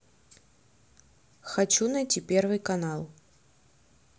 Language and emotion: Russian, neutral